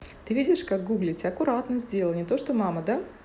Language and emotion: Russian, neutral